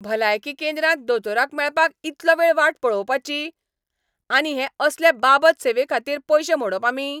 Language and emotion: Goan Konkani, angry